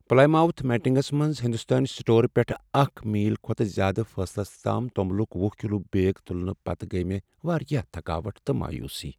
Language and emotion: Kashmiri, sad